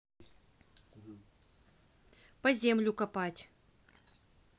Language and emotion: Russian, neutral